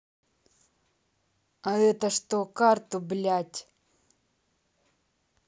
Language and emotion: Russian, angry